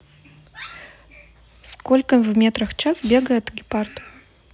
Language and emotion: Russian, neutral